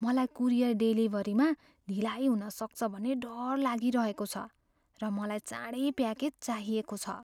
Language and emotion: Nepali, fearful